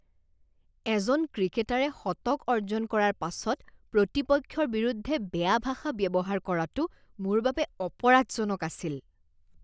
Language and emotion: Assamese, disgusted